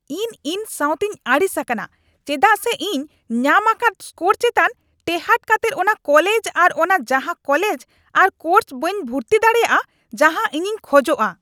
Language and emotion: Santali, angry